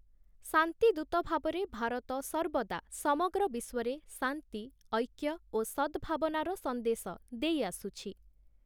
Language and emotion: Odia, neutral